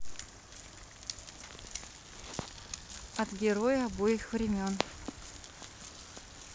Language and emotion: Russian, neutral